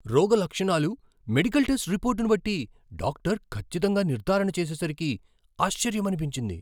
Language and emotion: Telugu, surprised